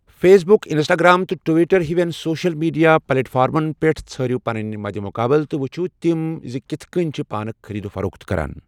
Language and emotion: Kashmiri, neutral